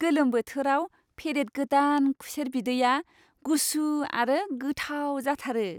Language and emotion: Bodo, happy